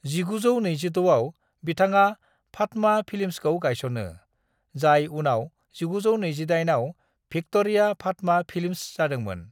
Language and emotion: Bodo, neutral